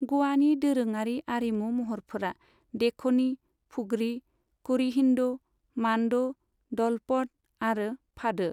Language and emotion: Bodo, neutral